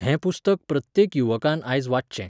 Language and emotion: Goan Konkani, neutral